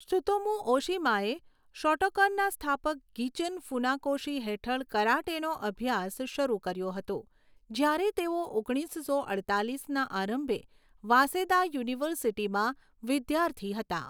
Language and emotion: Gujarati, neutral